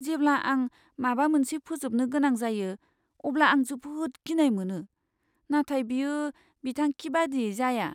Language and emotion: Bodo, fearful